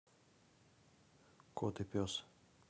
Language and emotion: Russian, neutral